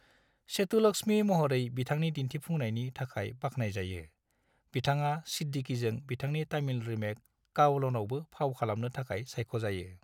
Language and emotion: Bodo, neutral